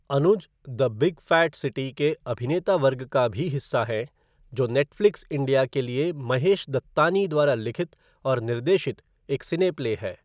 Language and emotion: Hindi, neutral